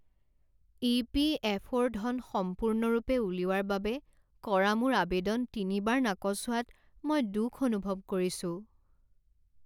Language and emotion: Assamese, sad